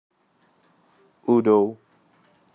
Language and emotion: Russian, neutral